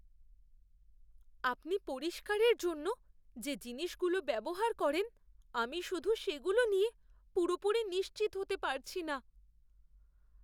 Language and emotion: Bengali, fearful